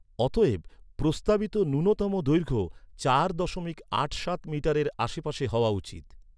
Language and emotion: Bengali, neutral